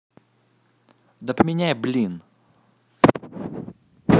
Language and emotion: Russian, angry